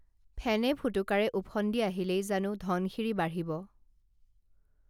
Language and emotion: Assamese, neutral